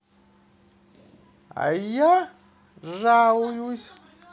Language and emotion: Russian, positive